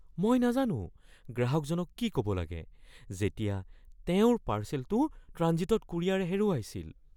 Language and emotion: Assamese, fearful